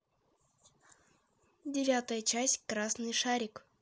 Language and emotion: Russian, neutral